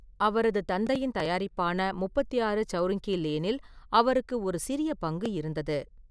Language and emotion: Tamil, neutral